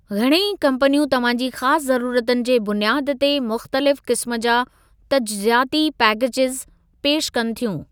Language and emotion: Sindhi, neutral